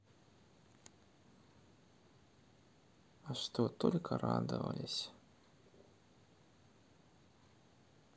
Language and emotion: Russian, sad